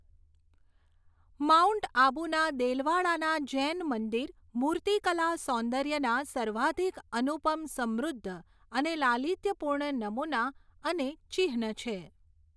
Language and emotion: Gujarati, neutral